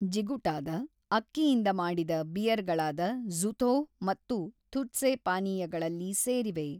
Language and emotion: Kannada, neutral